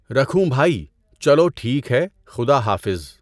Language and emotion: Urdu, neutral